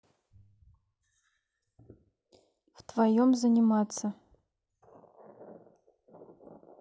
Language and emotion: Russian, neutral